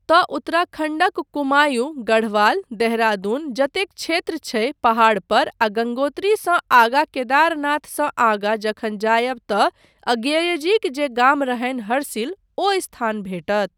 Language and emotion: Maithili, neutral